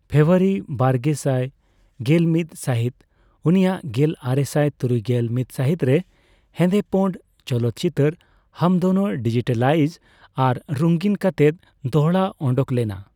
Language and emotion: Santali, neutral